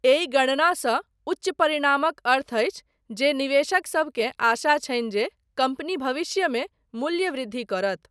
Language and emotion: Maithili, neutral